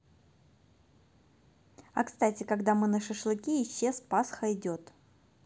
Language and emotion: Russian, neutral